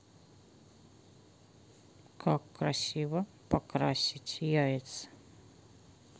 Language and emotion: Russian, neutral